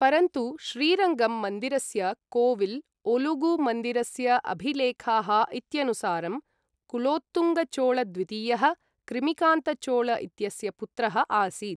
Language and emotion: Sanskrit, neutral